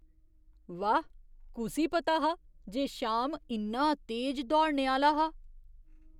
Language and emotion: Dogri, surprised